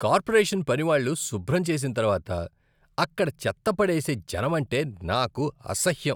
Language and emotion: Telugu, disgusted